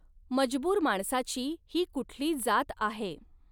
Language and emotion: Marathi, neutral